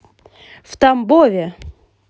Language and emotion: Russian, positive